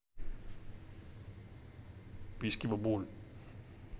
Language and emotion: Russian, neutral